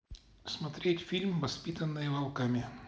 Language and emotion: Russian, neutral